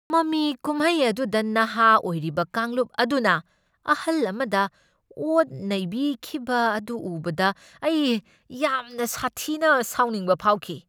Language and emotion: Manipuri, angry